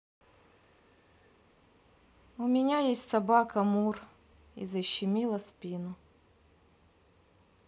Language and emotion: Russian, sad